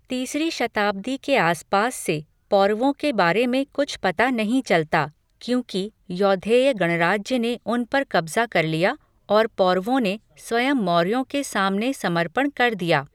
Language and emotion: Hindi, neutral